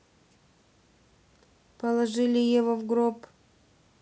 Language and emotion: Russian, neutral